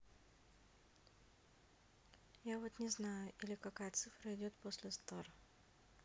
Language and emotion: Russian, neutral